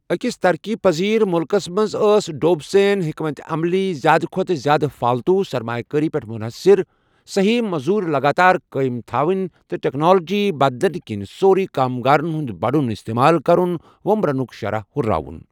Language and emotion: Kashmiri, neutral